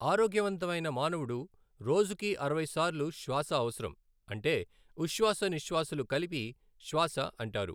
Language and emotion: Telugu, neutral